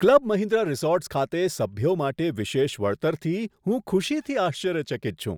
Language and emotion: Gujarati, surprised